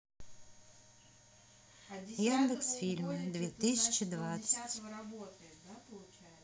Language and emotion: Russian, neutral